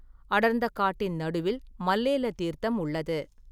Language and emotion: Tamil, neutral